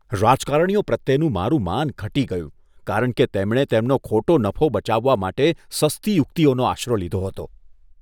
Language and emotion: Gujarati, disgusted